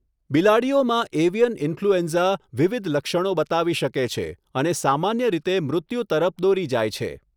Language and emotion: Gujarati, neutral